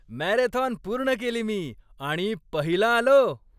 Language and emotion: Marathi, happy